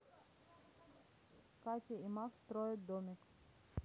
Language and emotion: Russian, neutral